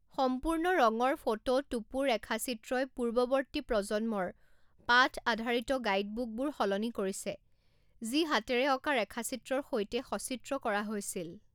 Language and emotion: Assamese, neutral